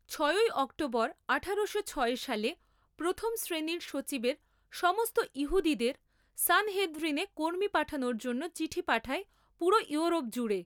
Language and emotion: Bengali, neutral